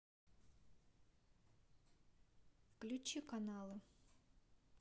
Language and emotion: Russian, neutral